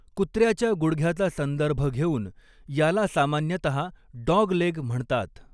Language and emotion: Marathi, neutral